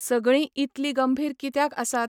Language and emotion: Goan Konkani, neutral